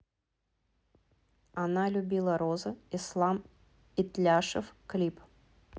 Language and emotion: Russian, neutral